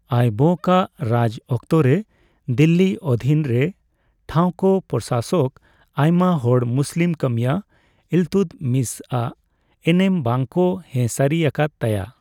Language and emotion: Santali, neutral